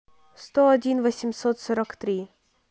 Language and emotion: Russian, neutral